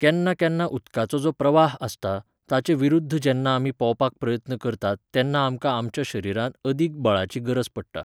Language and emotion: Goan Konkani, neutral